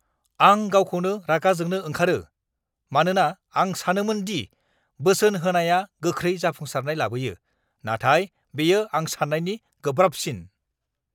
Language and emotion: Bodo, angry